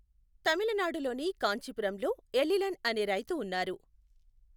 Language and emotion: Telugu, neutral